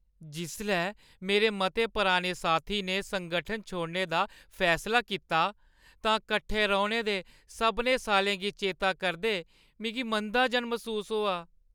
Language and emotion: Dogri, sad